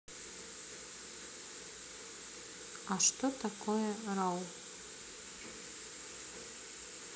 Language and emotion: Russian, neutral